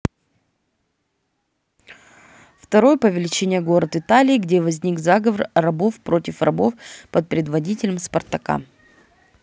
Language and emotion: Russian, neutral